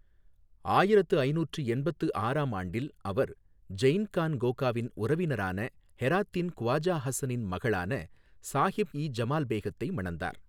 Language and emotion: Tamil, neutral